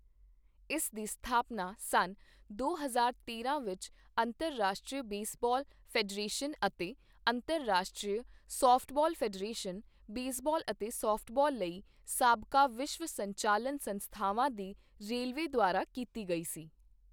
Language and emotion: Punjabi, neutral